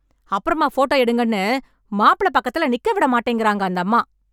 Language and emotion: Tamil, angry